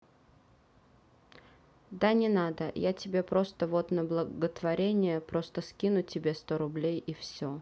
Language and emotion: Russian, neutral